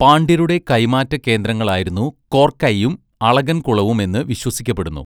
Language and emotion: Malayalam, neutral